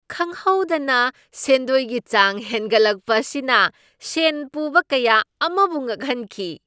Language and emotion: Manipuri, surprised